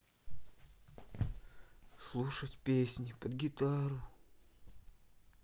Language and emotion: Russian, sad